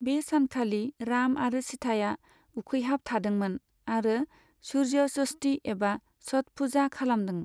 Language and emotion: Bodo, neutral